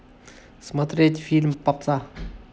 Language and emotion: Russian, neutral